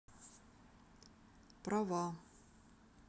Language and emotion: Russian, neutral